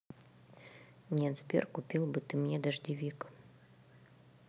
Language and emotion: Russian, neutral